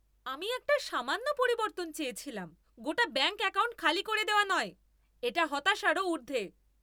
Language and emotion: Bengali, angry